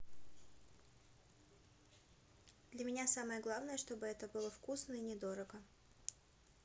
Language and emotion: Russian, neutral